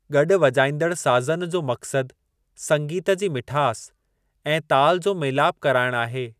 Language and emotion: Sindhi, neutral